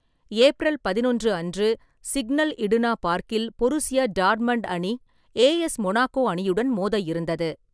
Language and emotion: Tamil, neutral